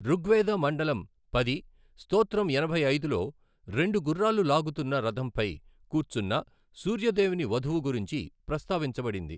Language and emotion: Telugu, neutral